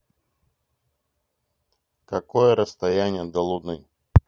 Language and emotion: Russian, neutral